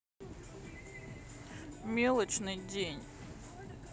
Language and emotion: Russian, sad